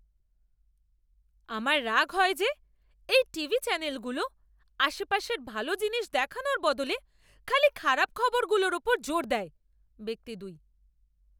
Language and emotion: Bengali, angry